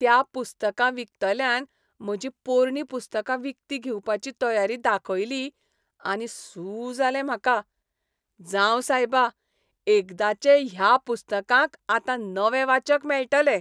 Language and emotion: Goan Konkani, happy